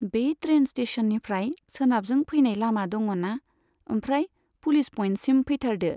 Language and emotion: Bodo, neutral